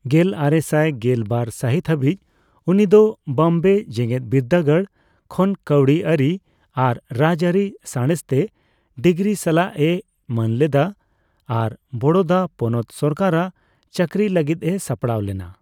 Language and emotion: Santali, neutral